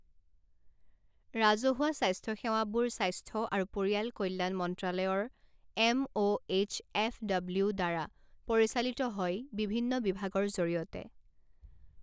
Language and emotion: Assamese, neutral